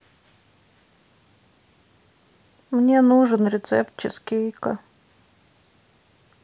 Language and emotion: Russian, sad